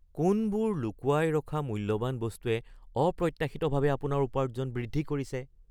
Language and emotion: Assamese, surprised